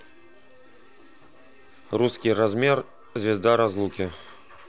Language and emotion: Russian, neutral